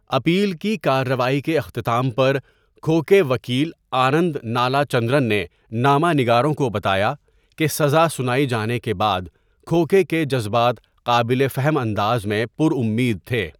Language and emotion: Urdu, neutral